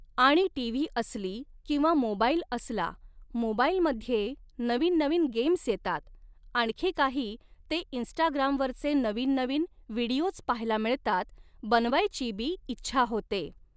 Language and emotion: Marathi, neutral